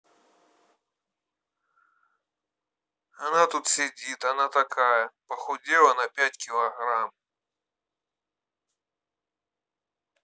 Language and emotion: Russian, neutral